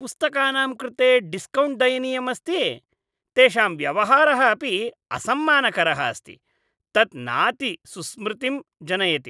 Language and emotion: Sanskrit, disgusted